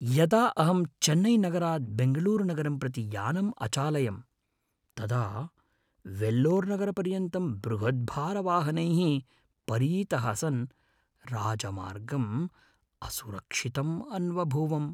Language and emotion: Sanskrit, fearful